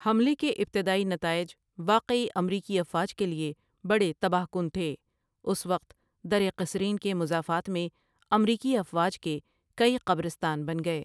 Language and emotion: Urdu, neutral